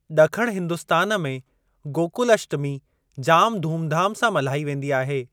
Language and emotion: Sindhi, neutral